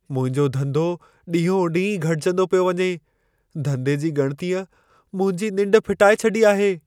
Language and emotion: Sindhi, fearful